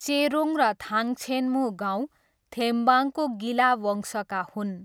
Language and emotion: Nepali, neutral